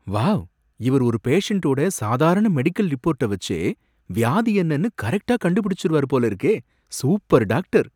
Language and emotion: Tamil, surprised